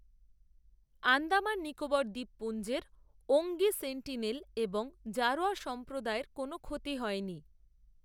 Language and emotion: Bengali, neutral